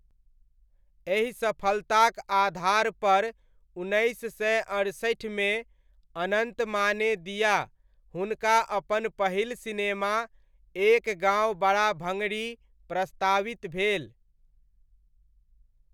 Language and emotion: Maithili, neutral